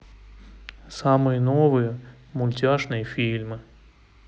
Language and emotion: Russian, neutral